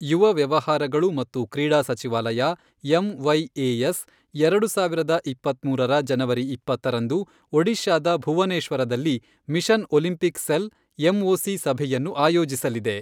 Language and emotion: Kannada, neutral